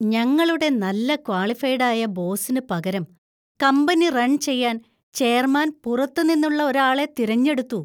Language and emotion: Malayalam, disgusted